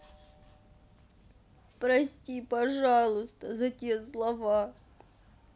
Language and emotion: Russian, sad